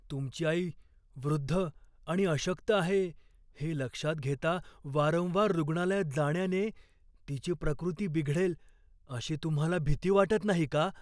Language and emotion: Marathi, fearful